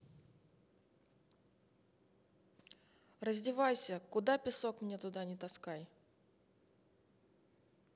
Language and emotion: Russian, neutral